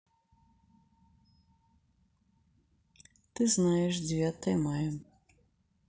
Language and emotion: Russian, neutral